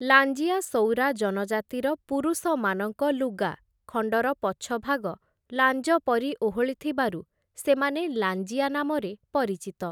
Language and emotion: Odia, neutral